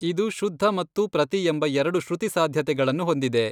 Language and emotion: Kannada, neutral